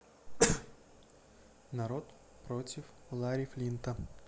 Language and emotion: Russian, neutral